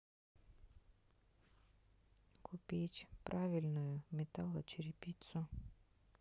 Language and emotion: Russian, neutral